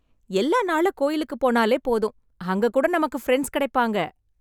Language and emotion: Tamil, happy